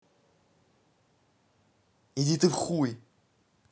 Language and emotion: Russian, angry